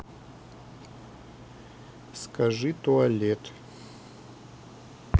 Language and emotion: Russian, neutral